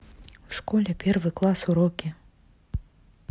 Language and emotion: Russian, neutral